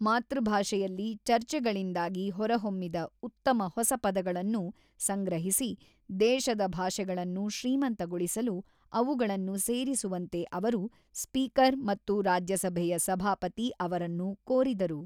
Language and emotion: Kannada, neutral